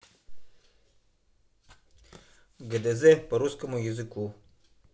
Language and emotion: Russian, neutral